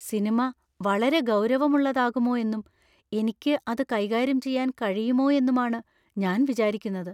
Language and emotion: Malayalam, fearful